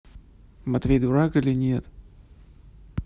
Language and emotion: Russian, neutral